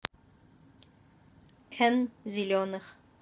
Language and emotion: Russian, neutral